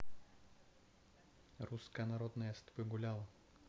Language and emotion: Russian, neutral